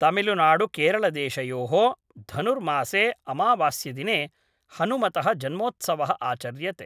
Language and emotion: Sanskrit, neutral